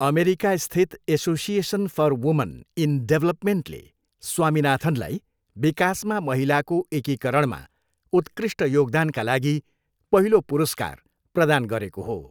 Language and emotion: Nepali, neutral